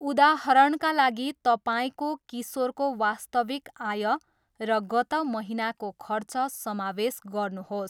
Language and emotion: Nepali, neutral